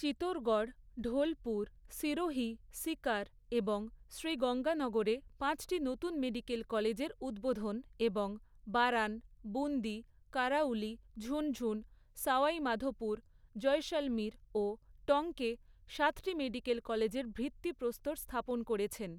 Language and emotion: Bengali, neutral